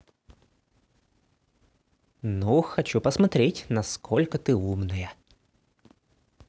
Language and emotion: Russian, positive